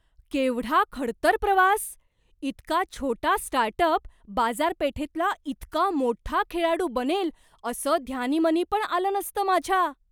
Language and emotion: Marathi, surprised